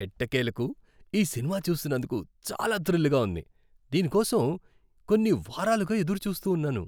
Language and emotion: Telugu, happy